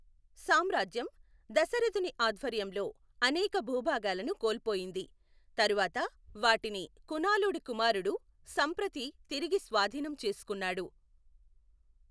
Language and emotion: Telugu, neutral